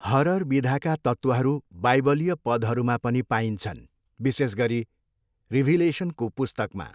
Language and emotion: Nepali, neutral